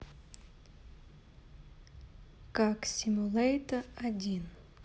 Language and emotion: Russian, neutral